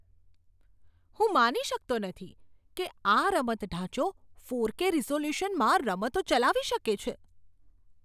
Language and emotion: Gujarati, surprised